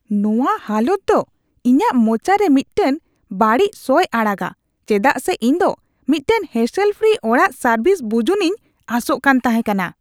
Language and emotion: Santali, disgusted